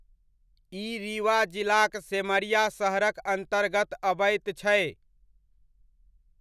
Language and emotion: Maithili, neutral